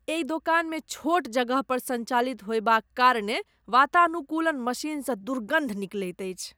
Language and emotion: Maithili, disgusted